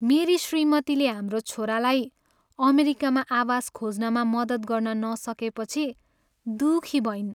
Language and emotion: Nepali, sad